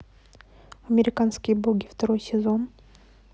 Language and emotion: Russian, neutral